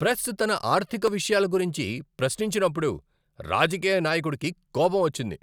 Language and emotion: Telugu, angry